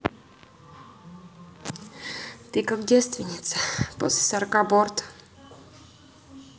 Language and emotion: Russian, neutral